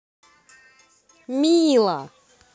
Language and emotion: Russian, positive